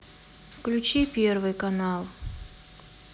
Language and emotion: Russian, neutral